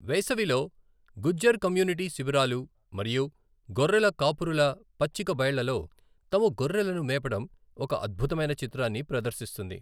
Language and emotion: Telugu, neutral